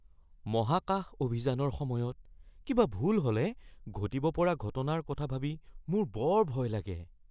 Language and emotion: Assamese, fearful